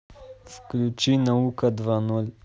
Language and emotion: Russian, neutral